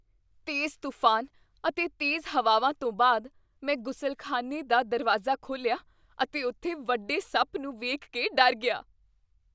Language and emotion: Punjabi, fearful